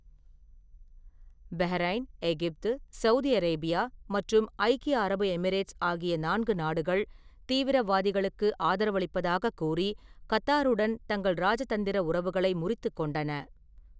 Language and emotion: Tamil, neutral